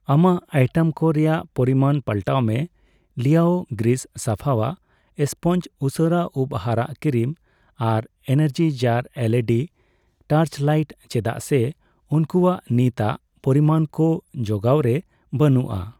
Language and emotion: Santali, neutral